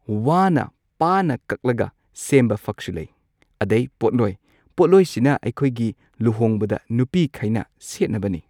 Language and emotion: Manipuri, neutral